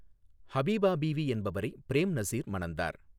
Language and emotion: Tamil, neutral